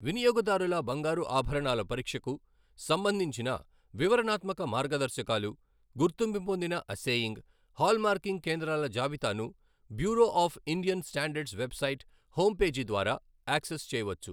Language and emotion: Telugu, neutral